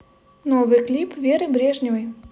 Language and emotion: Russian, positive